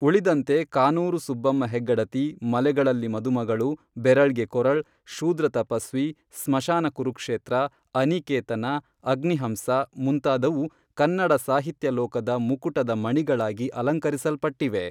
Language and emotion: Kannada, neutral